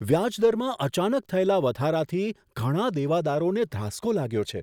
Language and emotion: Gujarati, surprised